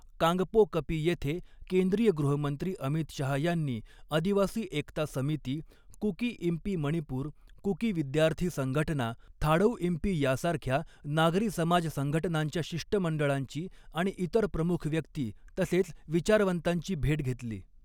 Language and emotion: Marathi, neutral